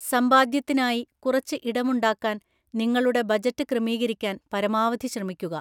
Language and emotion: Malayalam, neutral